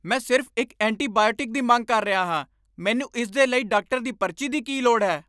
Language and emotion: Punjabi, angry